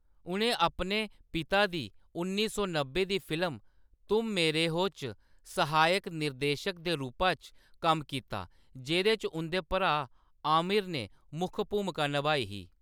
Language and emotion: Dogri, neutral